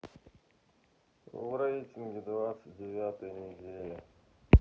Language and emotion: Russian, sad